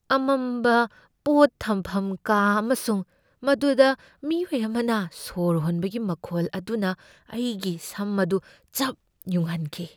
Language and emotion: Manipuri, fearful